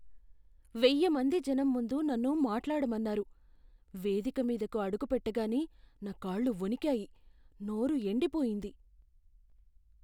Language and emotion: Telugu, fearful